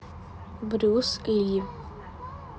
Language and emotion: Russian, neutral